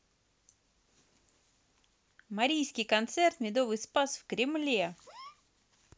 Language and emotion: Russian, positive